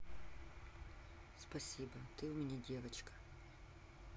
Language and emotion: Russian, neutral